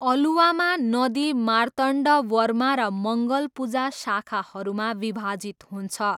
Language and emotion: Nepali, neutral